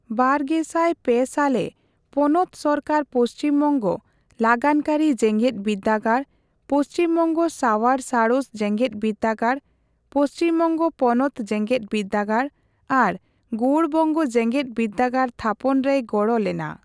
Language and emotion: Santali, neutral